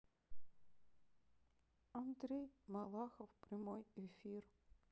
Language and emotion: Russian, neutral